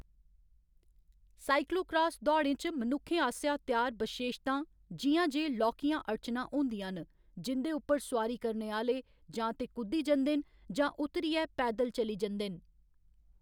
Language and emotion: Dogri, neutral